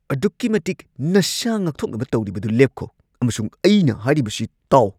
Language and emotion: Manipuri, angry